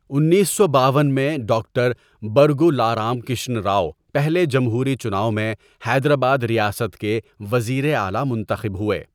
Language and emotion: Urdu, neutral